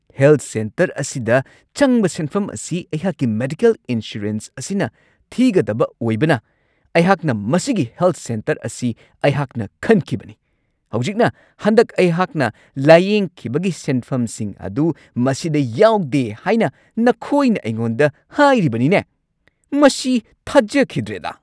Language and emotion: Manipuri, angry